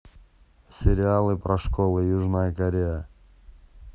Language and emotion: Russian, neutral